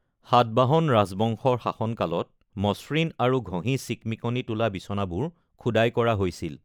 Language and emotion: Assamese, neutral